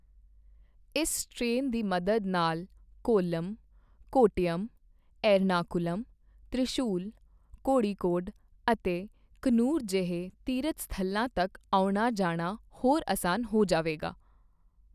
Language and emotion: Punjabi, neutral